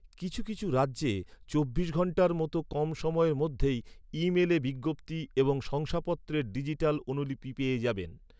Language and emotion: Bengali, neutral